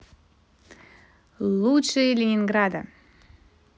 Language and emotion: Russian, positive